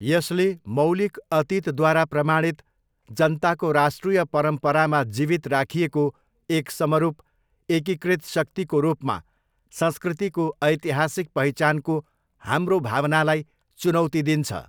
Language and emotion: Nepali, neutral